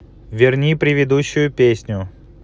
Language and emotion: Russian, angry